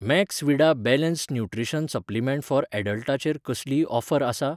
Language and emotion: Goan Konkani, neutral